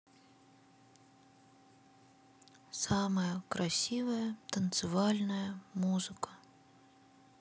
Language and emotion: Russian, sad